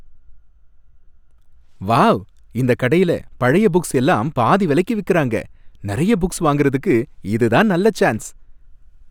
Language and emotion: Tamil, happy